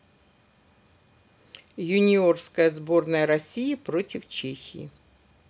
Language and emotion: Russian, neutral